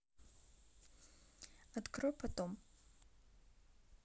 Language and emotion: Russian, neutral